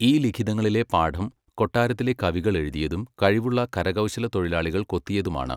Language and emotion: Malayalam, neutral